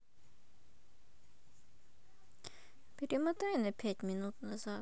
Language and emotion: Russian, sad